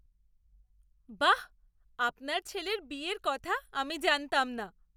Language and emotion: Bengali, surprised